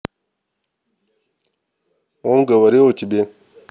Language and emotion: Russian, neutral